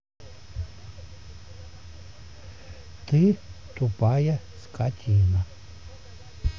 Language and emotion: Russian, neutral